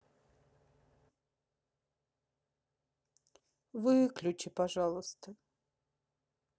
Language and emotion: Russian, sad